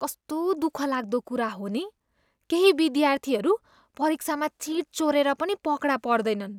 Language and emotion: Nepali, disgusted